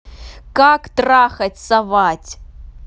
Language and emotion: Russian, angry